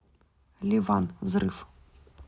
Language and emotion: Russian, neutral